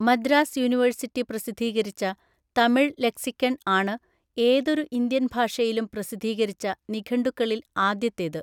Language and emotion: Malayalam, neutral